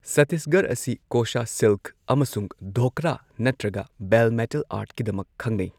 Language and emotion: Manipuri, neutral